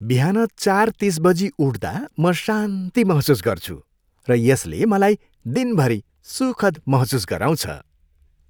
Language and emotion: Nepali, happy